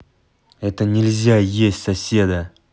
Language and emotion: Russian, angry